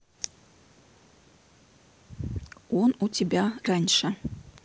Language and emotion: Russian, neutral